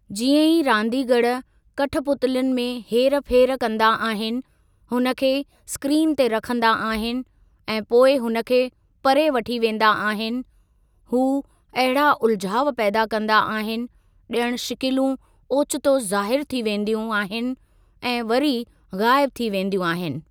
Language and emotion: Sindhi, neutral